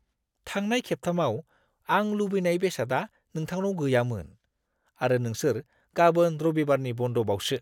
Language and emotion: Bodo, disgusted